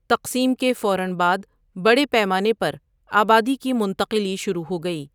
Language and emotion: Urdu, neutral